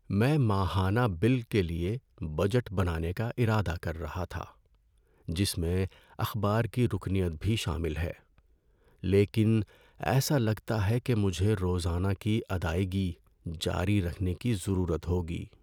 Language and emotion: Urdu, sad